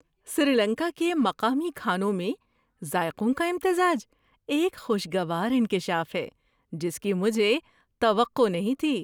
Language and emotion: Urdu, surprised